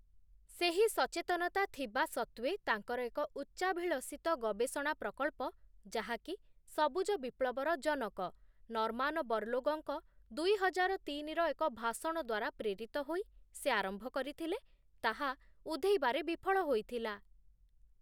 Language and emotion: Odia, neutral